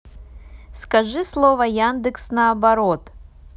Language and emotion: Russian, neutral